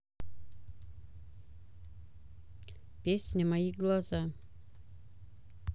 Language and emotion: Russian, neutral